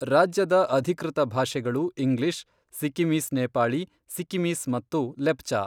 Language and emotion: Kannada, neutral